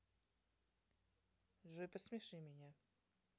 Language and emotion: Russian, neutral